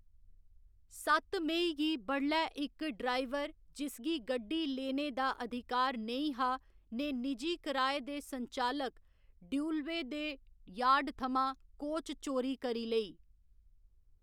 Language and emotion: Dogri, neutral